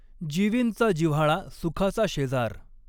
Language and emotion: Marathi, neutral